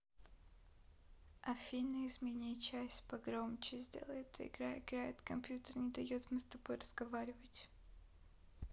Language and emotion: Russian, neutral